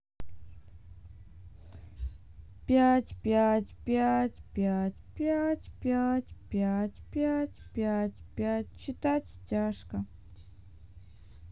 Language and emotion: Russian, sad